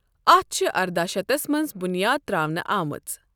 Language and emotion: Kashmiri, neutral